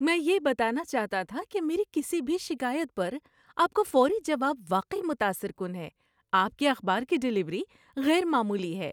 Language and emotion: Urdu, happy